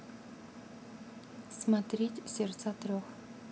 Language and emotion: Russian, neutral